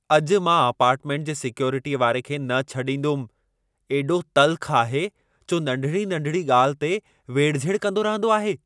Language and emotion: Sindhi, angry